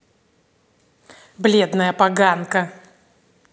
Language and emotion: Russian, angry